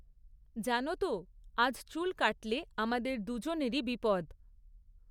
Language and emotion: Bengali, neutral